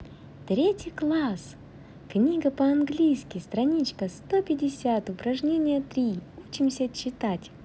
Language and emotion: Russian, positive